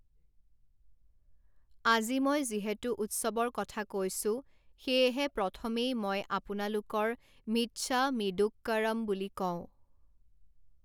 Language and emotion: Assamese, neutral